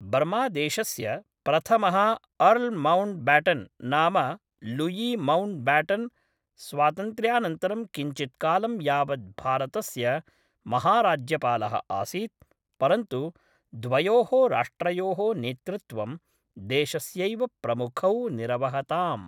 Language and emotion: Sanskrit, neutral